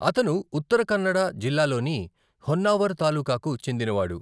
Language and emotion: Telugu, neutral